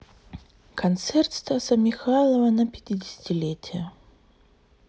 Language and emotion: Russian, sad